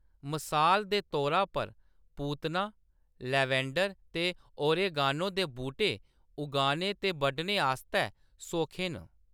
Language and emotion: Dogri, neutral